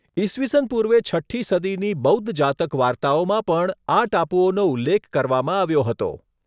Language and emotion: Gujarati, neutral